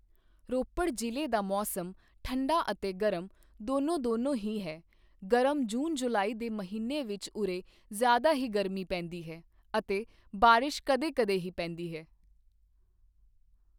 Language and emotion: Punjabi, neutral